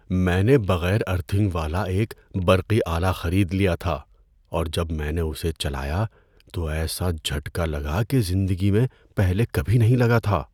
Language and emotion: Urdu, fearful